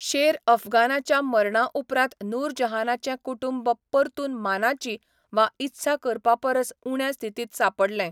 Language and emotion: Goan Konkani, neutral